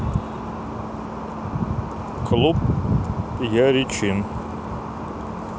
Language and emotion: Russian, neutral